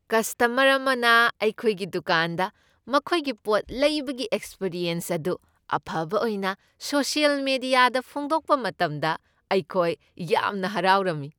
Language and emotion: Manipuri, happy